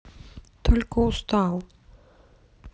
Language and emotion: Russian, sad